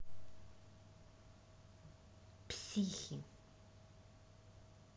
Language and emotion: Russian, angry